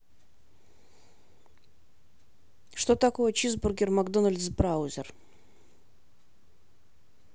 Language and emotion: Russian, neutral